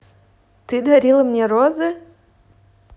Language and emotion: Russian, neutral